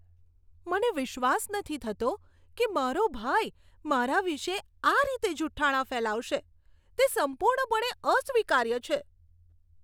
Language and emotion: Gujarati, disgusted